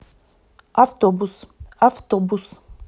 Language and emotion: Russian, neutral